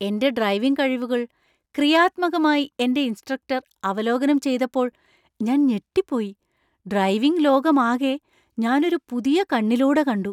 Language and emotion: Malayalam, surprised